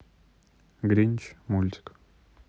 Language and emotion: Russian, neutral